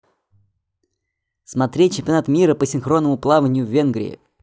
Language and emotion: Russian, positive